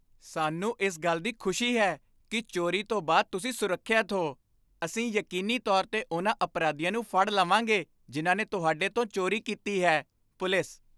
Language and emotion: Punjabi, happy